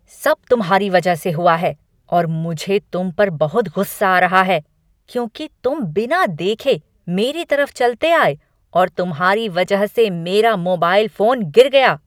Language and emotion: Hindi, angry